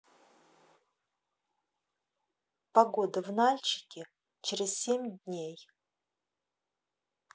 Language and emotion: Russian, neutral